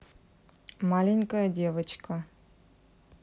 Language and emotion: Russian, neutral